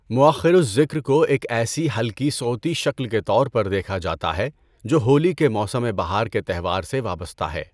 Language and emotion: Urdu, neutral